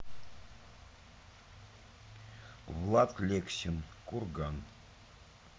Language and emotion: Russian, neutral